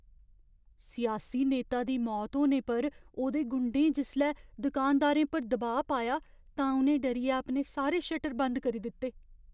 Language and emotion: Dogri, fearful